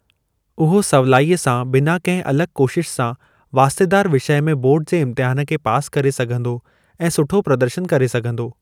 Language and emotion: Sindhi, neutral